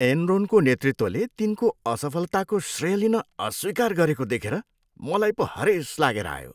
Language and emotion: Nepali, disgusted